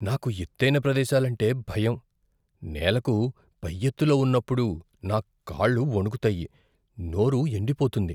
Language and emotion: Telugu, fearful